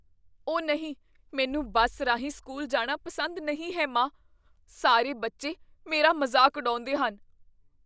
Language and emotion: Punjabi, fearful